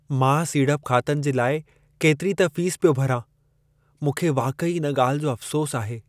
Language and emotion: Sindhi, sad